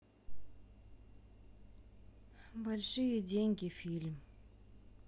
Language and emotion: Russian, neutral